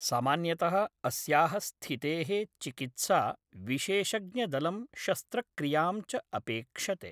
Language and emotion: Sanskrit, neutral